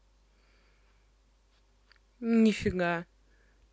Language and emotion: Russian, neutral